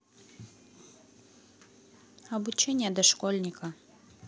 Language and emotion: Russian, neutral